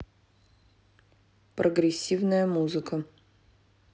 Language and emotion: Russian, neutral